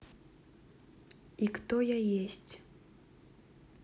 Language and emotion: Russian, neutral